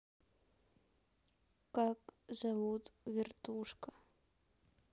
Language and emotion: Russian, neutral